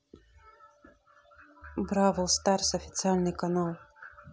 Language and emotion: Russian, neutral